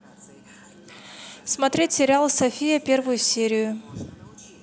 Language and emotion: Russian, neutral